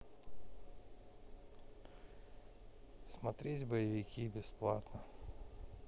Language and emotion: Russian, neutral